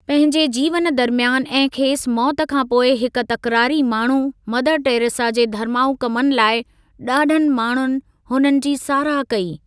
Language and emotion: Sindhi, neutral